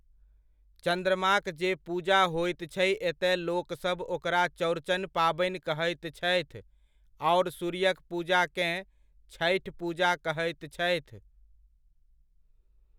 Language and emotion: Maithili, neutral